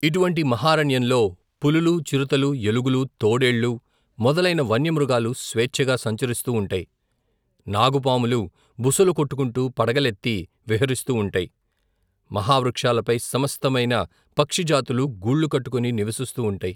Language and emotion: Telugu, neutral